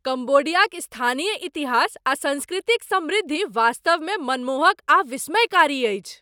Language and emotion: Maithili, surprised